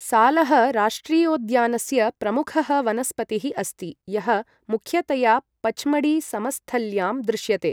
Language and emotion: Sanskrit, neutral